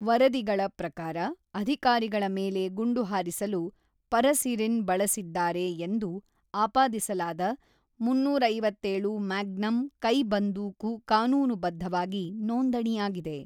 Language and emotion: Kannada, neutral